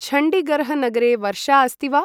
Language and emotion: Sanskrit, neutral